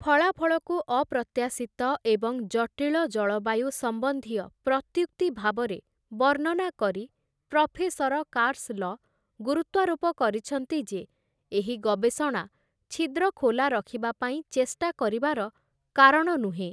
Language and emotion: Odia, neutral